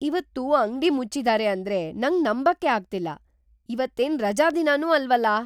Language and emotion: Kannada, surprised